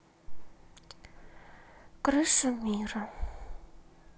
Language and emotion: Russian, sad